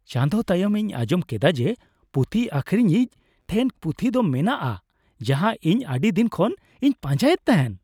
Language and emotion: Santali, happy